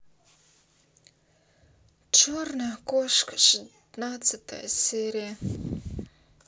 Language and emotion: Russian, sad